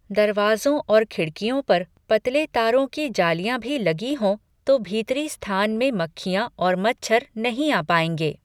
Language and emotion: Hindi, neutral